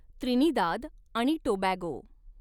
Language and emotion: Marathi, neutral